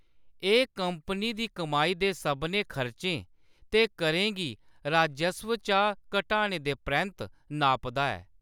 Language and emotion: Dogri, neutral